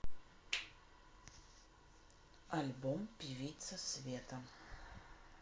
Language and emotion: Russian, neutral